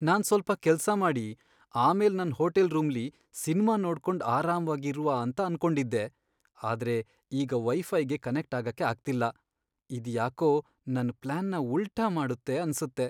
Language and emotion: Kannada, sad